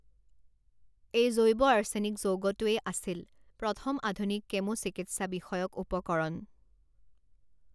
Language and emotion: Assamese, neutral